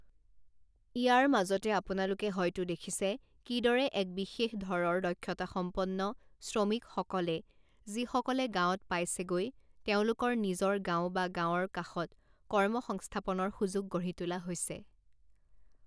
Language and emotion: Assamese, neutral